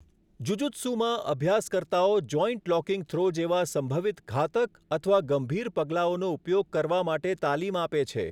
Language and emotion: Gujarati, neutral